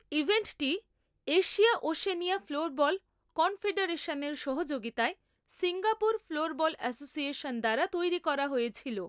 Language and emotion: Bengali, neutral